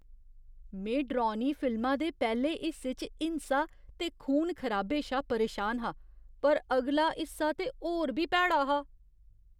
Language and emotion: Dogri, disgusted